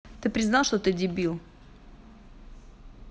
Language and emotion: Russian, angry